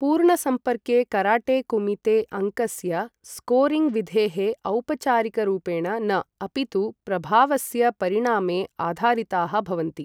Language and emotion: Sanskrit, neutral